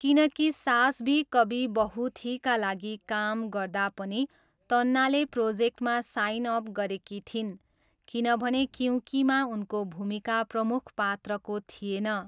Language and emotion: Nepali, neutral